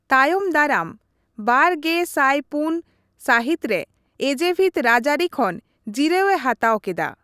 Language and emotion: Santali, neutral